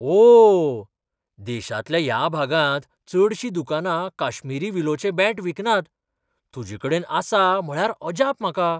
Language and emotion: Goan Konkani, surprised